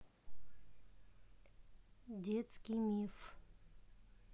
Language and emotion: Russian, neutral